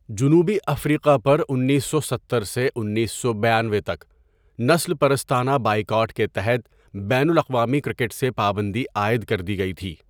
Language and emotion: Urdu, neutral